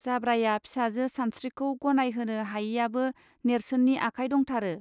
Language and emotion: Bodo, neutral